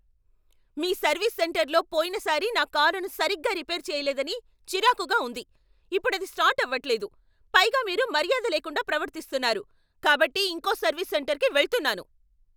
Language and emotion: Telugu, angry